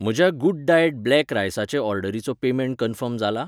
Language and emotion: Goan Konkani, neutral